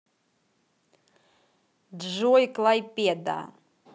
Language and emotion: Russian, positive